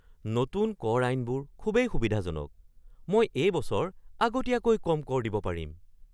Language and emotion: Assamese, surprised